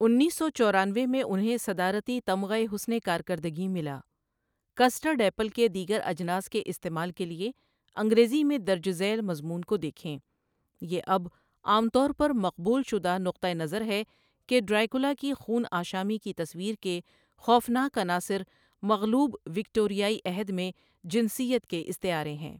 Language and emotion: Urdu, neutral